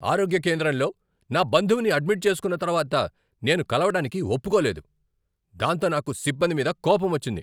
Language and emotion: Telugu, angry